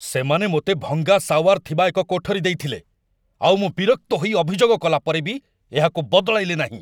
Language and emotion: Odia, angry